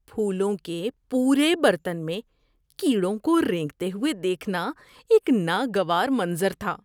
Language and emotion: Urdu, disgusted